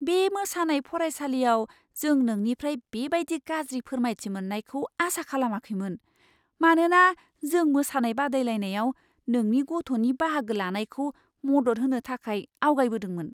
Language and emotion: Bodo, surprised